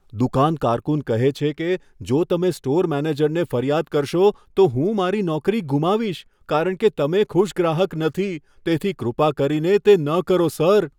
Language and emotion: Gujarati, fearful